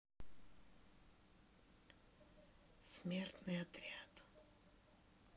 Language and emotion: Russian, sad